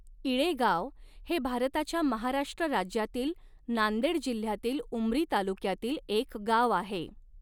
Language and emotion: Marathi, neutral